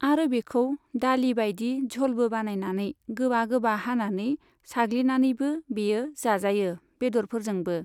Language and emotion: Bodo, neutral